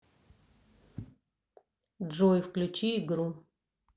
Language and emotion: Russian, neutral